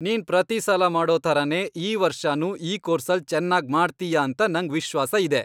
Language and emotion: Kannada, happy